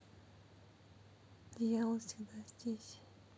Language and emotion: Russian, sad